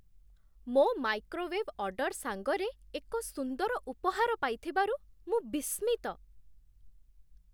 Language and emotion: Odia, surprised